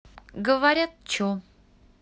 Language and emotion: Russian, neutral